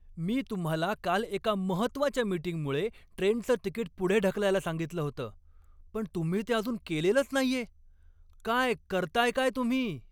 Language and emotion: Marathi, angry